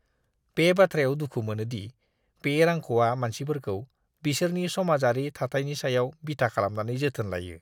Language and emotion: Bodo, disgusted